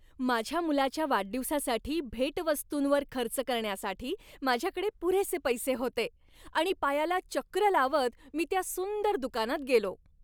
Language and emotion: Marathi, happy